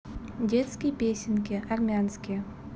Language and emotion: Russian, neutral